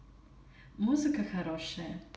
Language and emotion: Russian, positive